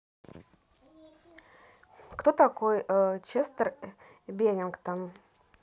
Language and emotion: Russian, neutral